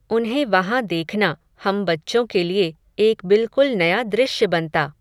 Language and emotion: Hindi, neutral